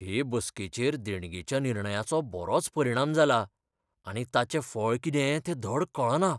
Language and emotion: Goan Konkani, fearful